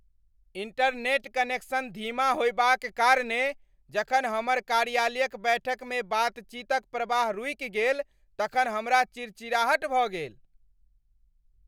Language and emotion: Maithili, angry